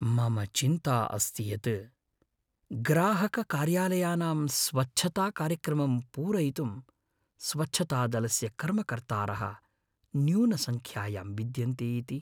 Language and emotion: Sanskrit, fearful